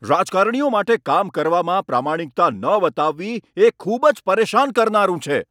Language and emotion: Gujarati, angry